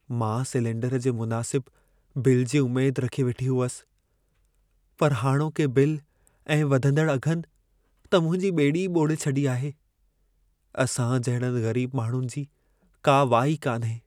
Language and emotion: Sindhi, sad